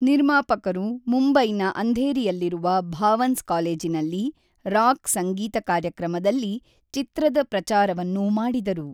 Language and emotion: Kannada, neutral